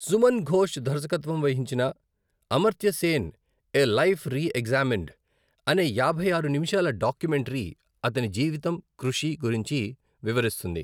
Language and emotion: Telugu, neutral